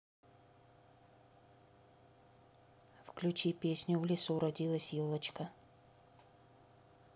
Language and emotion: Russian, neutral